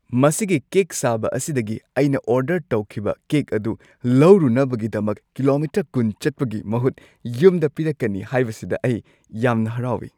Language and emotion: Manipuri, happy